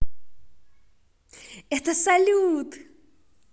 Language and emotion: Russian, positive